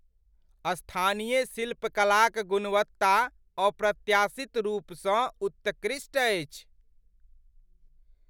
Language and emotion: Maithili, surprised